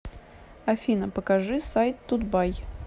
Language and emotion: Russian, neutral